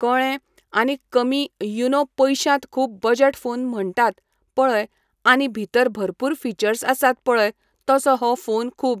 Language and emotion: Goan Konkani, neutral